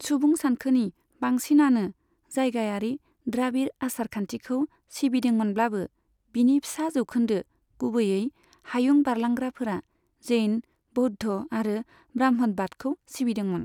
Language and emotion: Bodo, neutral